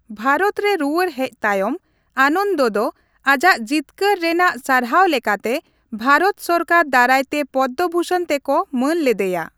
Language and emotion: Santali, neutral